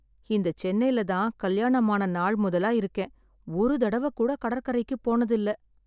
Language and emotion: Tamil, sad